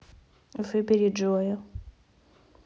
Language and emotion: Russian, neutral